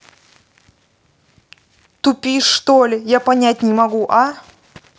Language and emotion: Russian, angry